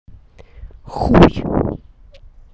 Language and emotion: Russian, angry